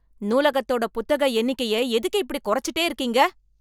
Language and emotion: Tamil, angry